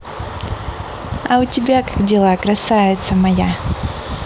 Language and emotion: Russian, positive